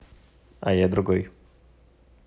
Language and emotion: Russian, neutral